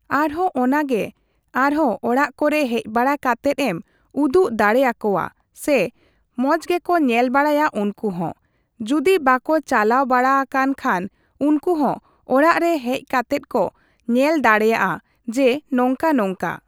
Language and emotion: Santali, neutral